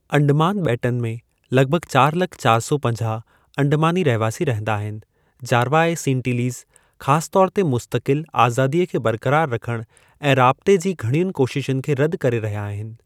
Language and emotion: Sindhi, neutral